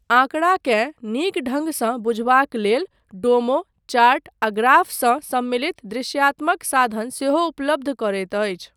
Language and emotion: Maithili, neutral